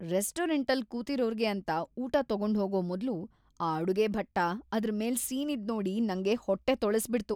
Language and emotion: Kannada, disgusted